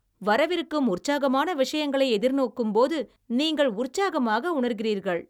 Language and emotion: Tamil, happy